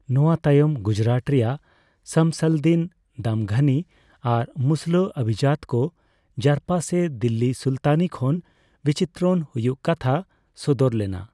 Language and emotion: Santali, neutral